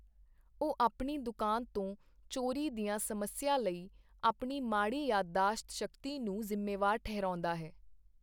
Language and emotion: Punjabi, neutral